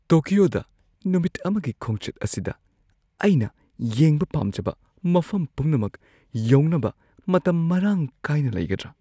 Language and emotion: Manipuri, fearful